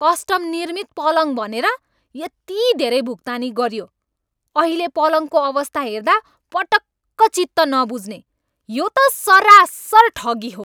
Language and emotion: Nepali, angry